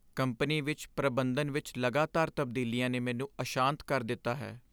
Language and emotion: Punjabi, sad